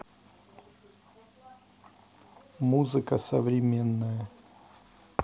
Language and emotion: Russian, neutral